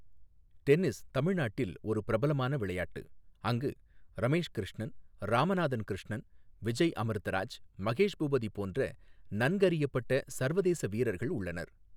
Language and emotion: Tamil, neutral